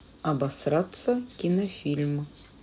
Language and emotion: Russian, neutral